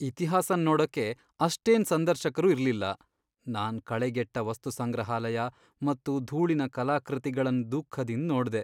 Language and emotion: Kannada, sad